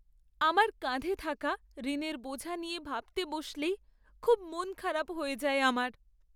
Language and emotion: Bengali, sad